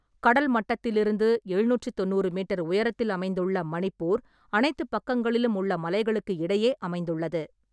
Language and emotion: Tamil, neutral